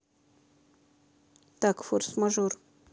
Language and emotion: Russian, neutral